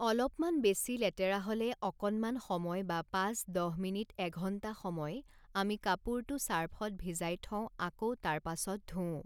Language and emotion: Assamese, neutral